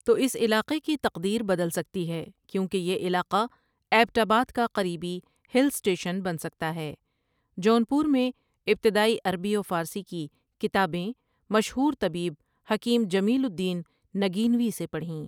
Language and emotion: Urdu, neutral